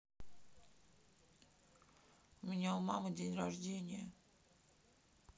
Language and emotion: Russian, sad